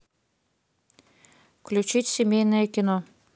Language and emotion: Russian, neutral